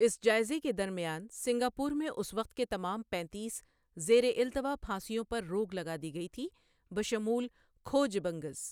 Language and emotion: Urdu, neutral